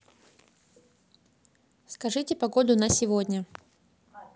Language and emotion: Russian, neutral